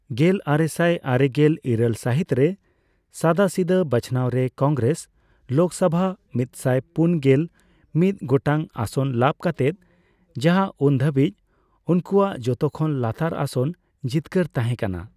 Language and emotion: Santali, neutral